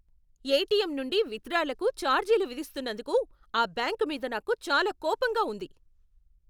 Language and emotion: Telugu, angry